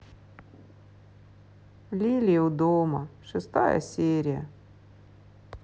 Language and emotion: Russian, sad